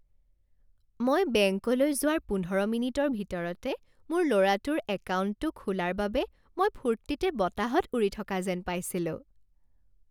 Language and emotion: Assamese, happy